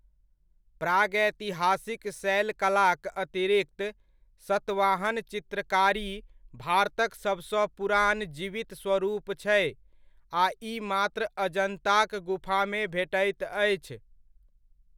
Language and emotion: Maithili, neutral